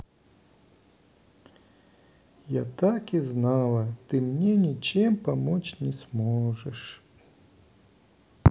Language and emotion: Russian, sad